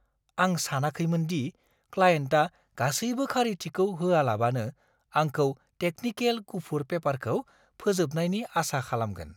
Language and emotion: Bodo, surprised